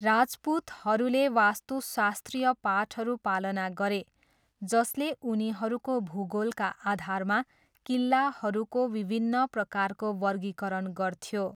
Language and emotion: Nepali, neutral